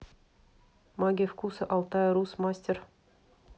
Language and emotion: Russian, neutral